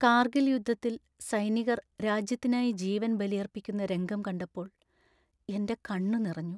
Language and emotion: Malayalam, sad